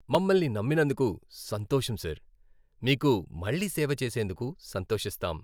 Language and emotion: Telugu, happy